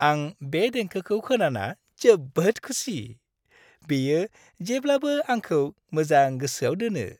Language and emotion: Bodo, happy